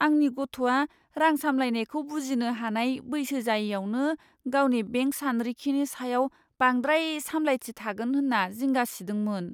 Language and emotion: Bodo, fearful